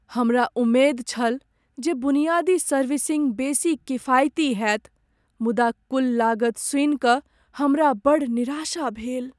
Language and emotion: Maithili, sad